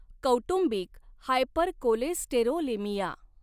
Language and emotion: Marathi, neutral